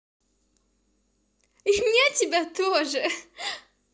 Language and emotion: Russian, positive